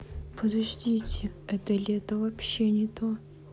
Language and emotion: Russian, sad